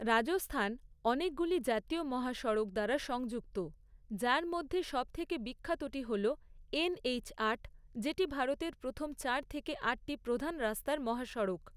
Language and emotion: Bengali, neutral